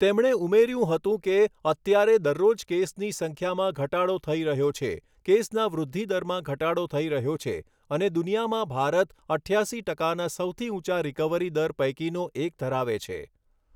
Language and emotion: Gujarati, neutral